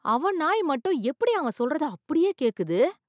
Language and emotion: Tamil, surprised